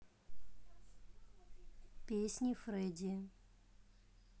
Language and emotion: Russian, neutral